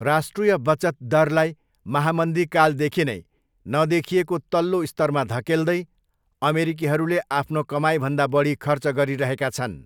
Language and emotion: Nepali, neutral